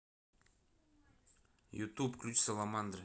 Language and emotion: Russian, neutral